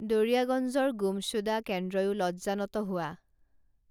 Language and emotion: Assamese, neutral